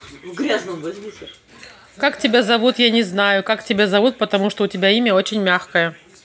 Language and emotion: Russian, neutral